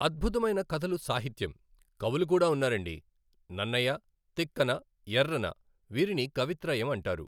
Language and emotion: Telugu, neutral